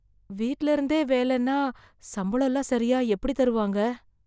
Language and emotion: Tamil, fearful